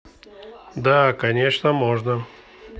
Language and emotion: Russian, neutral